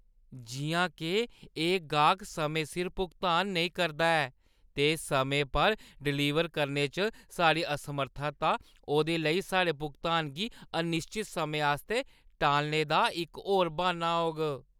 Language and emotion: Dogri, disgusted